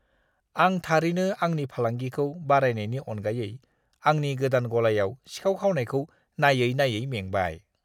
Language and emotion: Bodo, disgusted